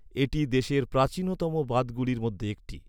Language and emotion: Bengali, neutral